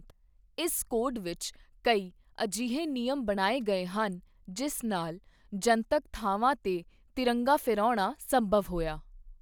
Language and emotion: Punjabi, neutral